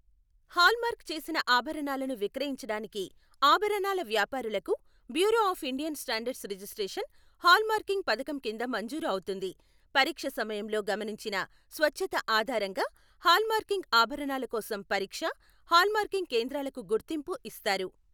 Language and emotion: Telugu, neutral